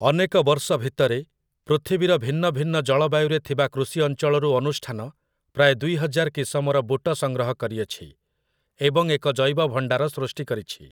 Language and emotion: Odia, neutral